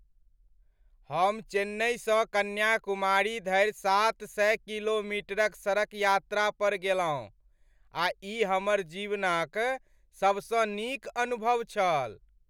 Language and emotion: Maithili, happy